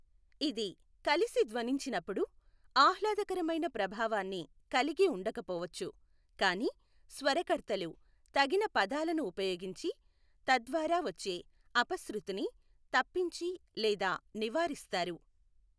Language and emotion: Telugu, neutral